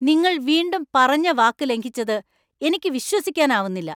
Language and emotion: Malayalam, angry